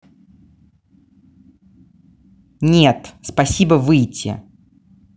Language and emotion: Russian, angry